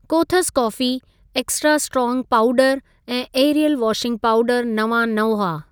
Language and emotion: Sindhi, neutral